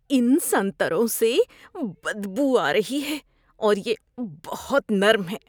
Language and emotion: Urdu, disgusted